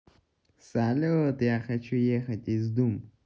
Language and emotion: Russian, positive